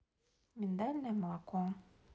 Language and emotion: Russian, neutral